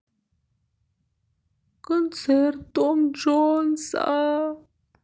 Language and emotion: Russian, sad